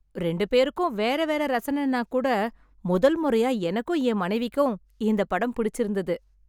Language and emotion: Tamil, happy